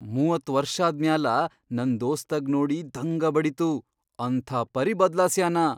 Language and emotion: Kannada, surprised